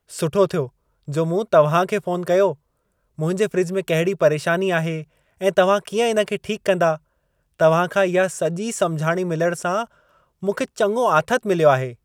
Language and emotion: Sindhi, happy